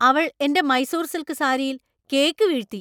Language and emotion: Malayalam, angry